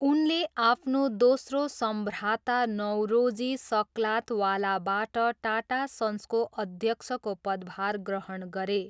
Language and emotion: Nepali, neutral